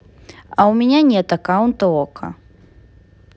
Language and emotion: Russian, neutral